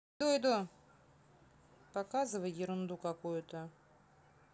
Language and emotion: Russian, neutral